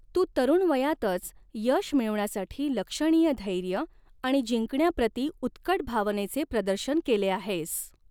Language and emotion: Marathi, neutral